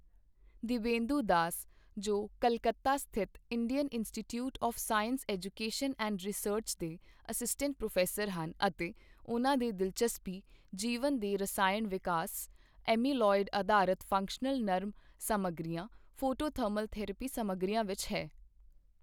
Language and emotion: Punjabi, neutral